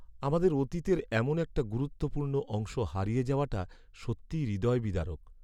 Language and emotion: Bengali, sad